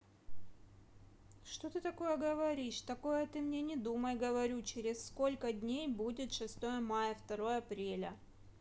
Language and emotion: Russian, angry